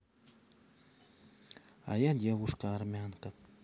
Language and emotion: Russian, neutral